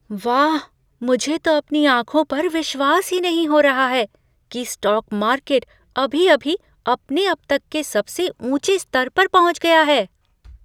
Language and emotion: Hindi, surprised